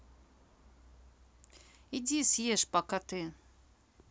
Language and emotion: Russian, neutral